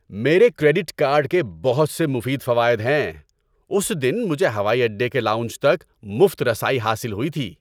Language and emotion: Urdu, happy